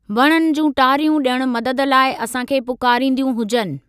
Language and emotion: Sindhi, neutral